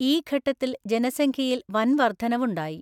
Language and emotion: Malayalam, neutral